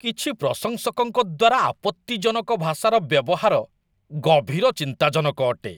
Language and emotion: Odia, disgusted